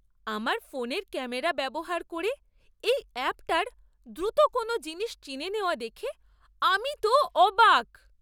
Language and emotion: Bengali, surprised